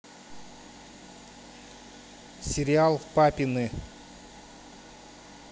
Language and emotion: Russian, neutral